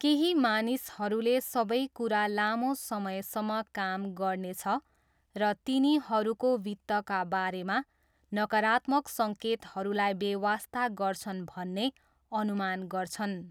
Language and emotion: Nepali, neutral